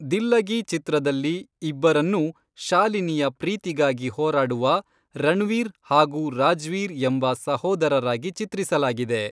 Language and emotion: Kannada, neutral